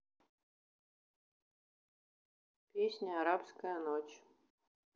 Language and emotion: Russian, neutral